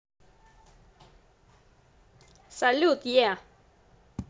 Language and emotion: Russian, positive